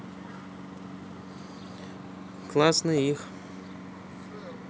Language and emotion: Russian, neutral